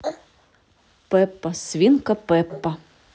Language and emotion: Russian, neutral